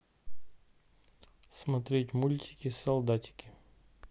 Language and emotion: Russian, neutral